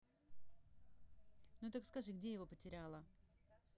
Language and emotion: Russian, neutral